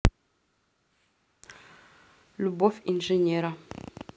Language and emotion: Russian, neutral